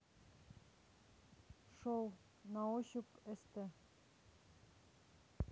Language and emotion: Russian, neutral